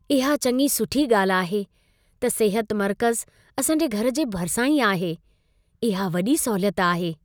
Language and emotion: Sindhi, happy